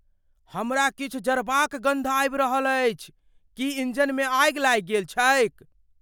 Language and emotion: Maithili, fearful